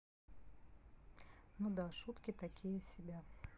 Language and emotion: Russian, neutral